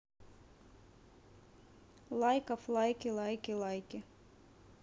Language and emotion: Russian, neutral